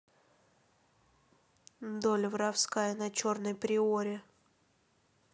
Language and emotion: Russian, neutral